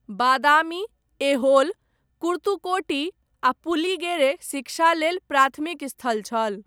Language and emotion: Maithili, neutral